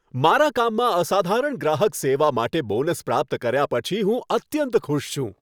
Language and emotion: Gujarati, happy